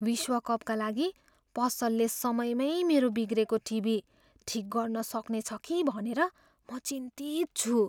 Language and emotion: Nepali, fearful